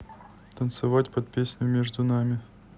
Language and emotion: Russian, neutral